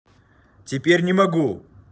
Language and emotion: Russian, angry